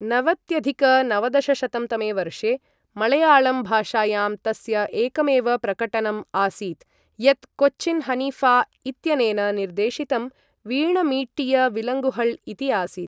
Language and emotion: Sanskrit, neutral